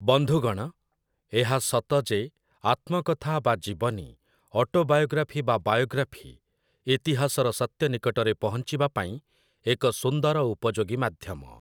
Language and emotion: Odia, neutral